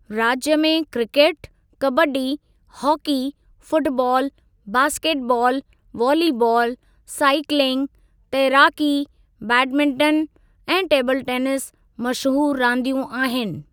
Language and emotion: Sindhi, neutral